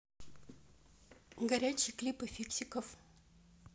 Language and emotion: Russian, neutral